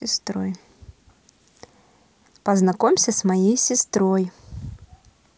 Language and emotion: Russian, neutral